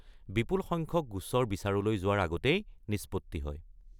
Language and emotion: Assamese, neutral